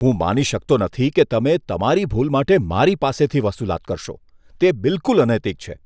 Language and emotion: Gujarati, disgusted